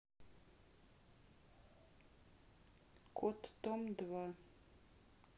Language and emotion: Russian, neutral